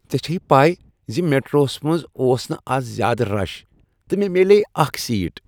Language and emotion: Kashmiri, happy